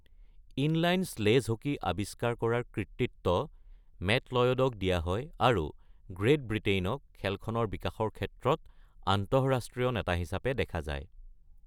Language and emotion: Assamese, neutral